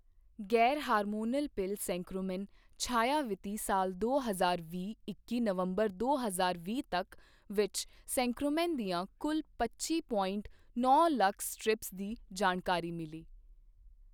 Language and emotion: Punjabi, neutral